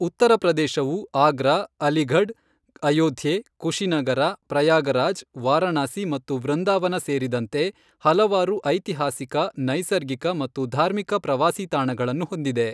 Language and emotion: Kannada, neutral